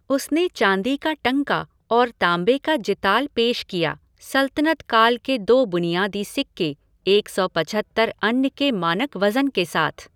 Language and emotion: Hindi, neutral